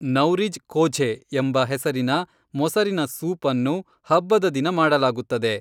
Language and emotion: Kannada, neutral